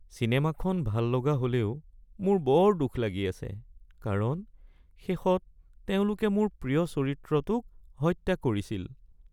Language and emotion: Assamese, sad